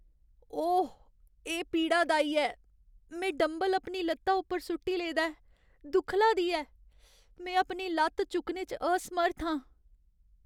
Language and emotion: Dogri, sad